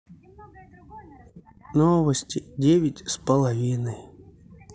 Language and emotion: Russian, neutral